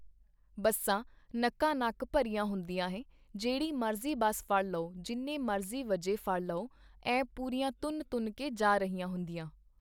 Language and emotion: Punjabi, neutral